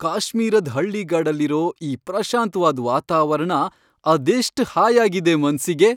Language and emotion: Kannada, happy